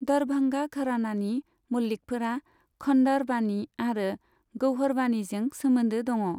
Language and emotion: Bodo, neutral